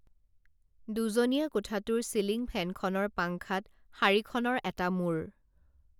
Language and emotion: Assamese, neutral